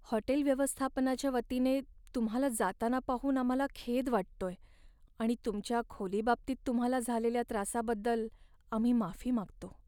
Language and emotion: Marathi, sad